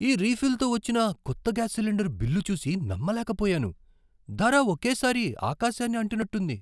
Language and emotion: Telugu, surprised